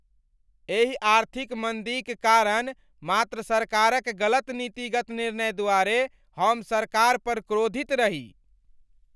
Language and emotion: Maithili, angry